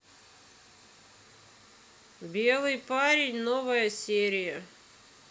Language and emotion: Russian, neutral